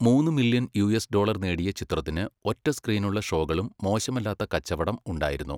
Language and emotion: Malayalam, neutral